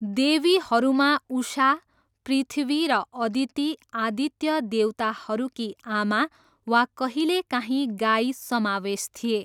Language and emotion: Nepali, neutral